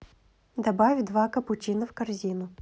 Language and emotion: Russian, neutral